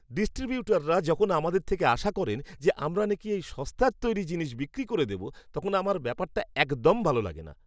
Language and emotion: Bengali, disgusted